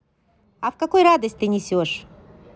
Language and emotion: Russian, positive